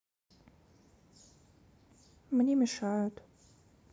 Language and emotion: Russian, sad